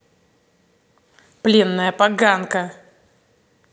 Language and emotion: Russian, angry